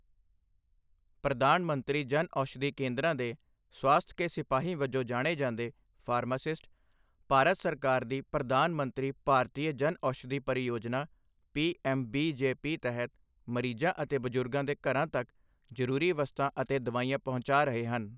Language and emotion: Punjabi, neutral